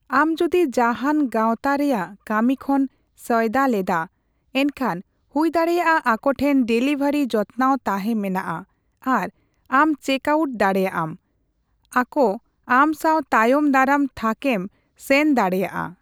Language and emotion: Santali, neutral